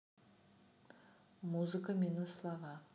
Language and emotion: Russian, neutral